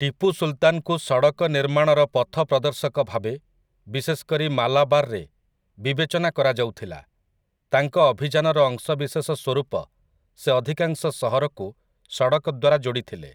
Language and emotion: Odia, neutral